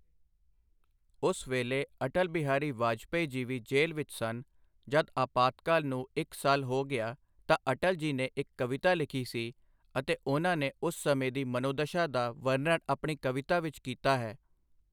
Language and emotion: Punjabi, neutral